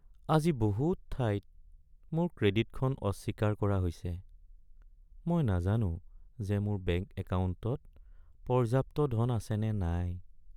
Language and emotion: Assamese, sad